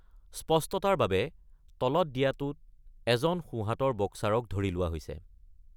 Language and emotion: Assamese, neutral